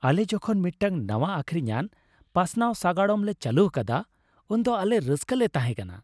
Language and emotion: Santali, happy